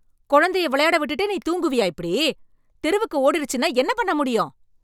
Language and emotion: Tamil, angry